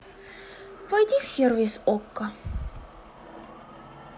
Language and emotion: Russian, sad